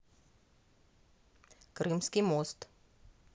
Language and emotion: Russian, neutral